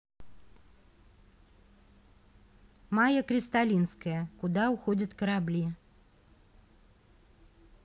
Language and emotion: Russian, neutral